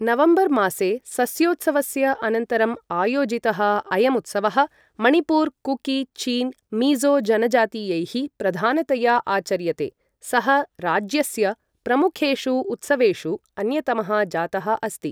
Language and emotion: Sanskrit, neutral